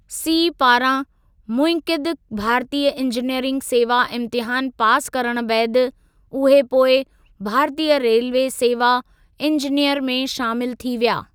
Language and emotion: Sindhi, neutral